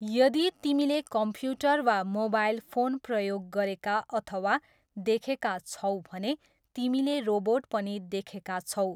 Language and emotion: Nepali, neutral